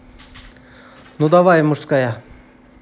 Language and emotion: Russian, neutral